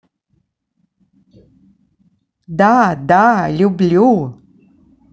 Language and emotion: Russian, positive